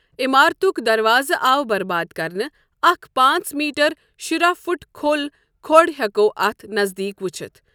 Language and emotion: Kashmiri, neutral